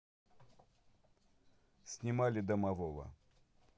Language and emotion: Russian, neutral